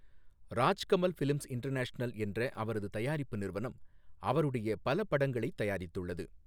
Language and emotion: Tamil, neutral